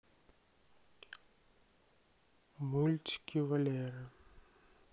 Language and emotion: Russian, sad